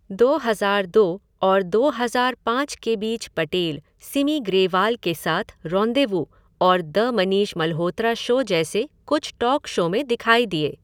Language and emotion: Hindi, neutral